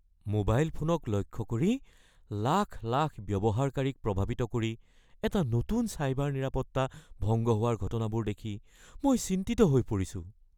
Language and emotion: Assamese, fearful